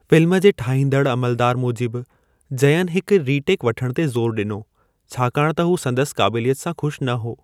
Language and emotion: Sindhi, neutral